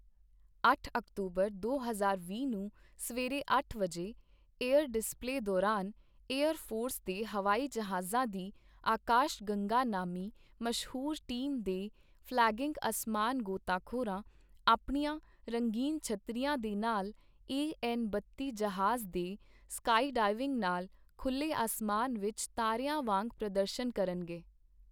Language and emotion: Punjabi, neutral